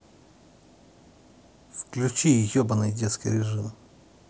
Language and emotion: Russian, angry